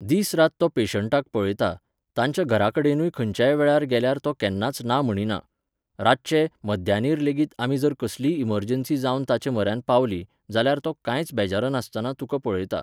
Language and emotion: Goan Konkani, neutral